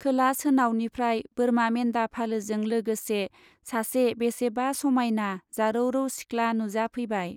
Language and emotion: Bodo, neutral